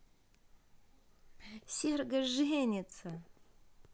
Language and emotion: Russian, positive